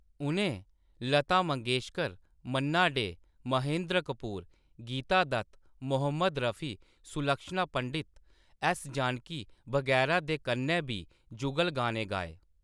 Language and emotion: Dogri, neutral